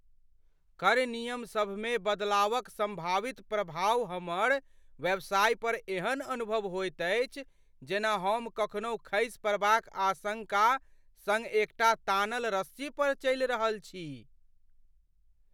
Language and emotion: Maithili, fearful